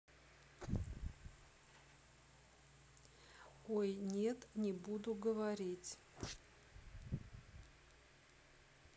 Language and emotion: Russian, neutral